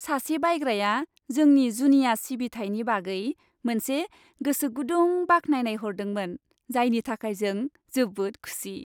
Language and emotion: Bodo, happy